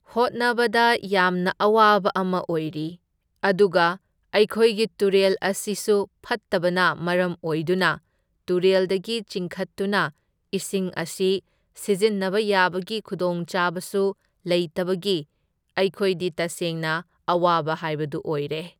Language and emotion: Manipuri, neutral